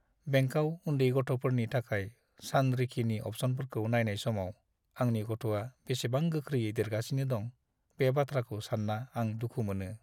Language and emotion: Bodo, sad